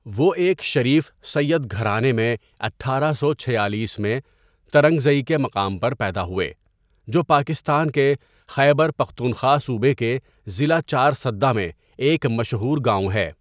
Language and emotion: Urdu, neutral